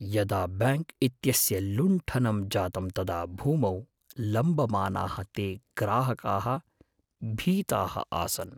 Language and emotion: Sanskrit, fearful